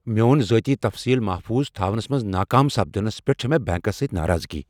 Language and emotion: Kashmiri, angry